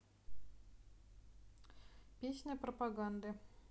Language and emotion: Russian, neutral